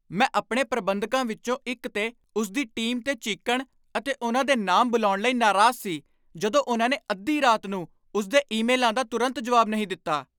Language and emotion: Punjabi, angry